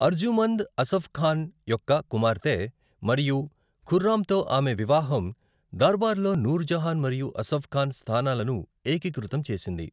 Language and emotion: Telugu, neutral